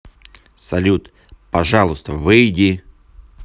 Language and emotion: Russian, neutral